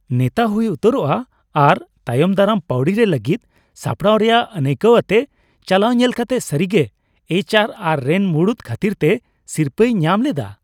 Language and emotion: Santali, happy